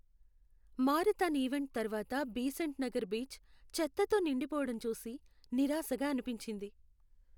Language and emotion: Telugu, sad